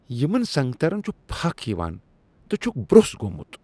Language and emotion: Kashmiri, disgusted